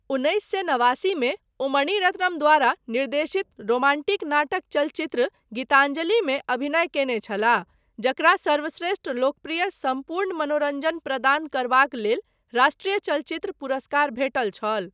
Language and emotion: Maithili, neutral